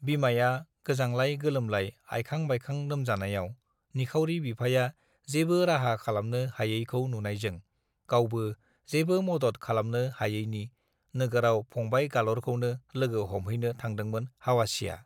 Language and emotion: Bodo, neutral